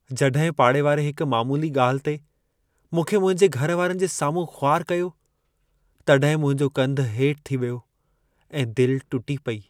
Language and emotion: Sindhi, sad